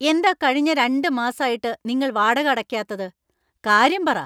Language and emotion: Malayalam, angry